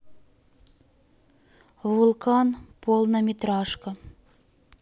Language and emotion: Russian, neutral